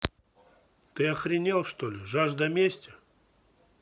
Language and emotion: Russian, angry